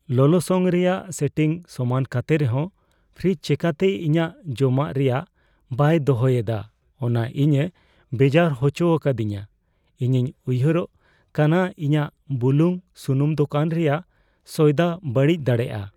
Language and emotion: Santali, fearful